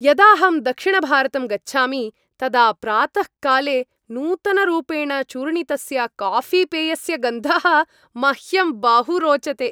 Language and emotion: Sanskrit, happy